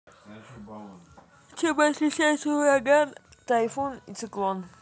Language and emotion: Russian, neutral